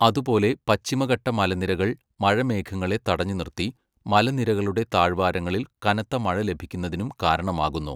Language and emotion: Malayalam, neutral